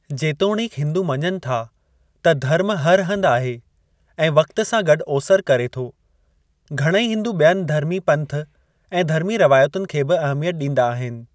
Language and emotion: Sindhi, neutral